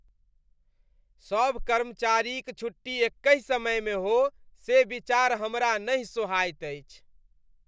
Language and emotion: Maithili, disgusted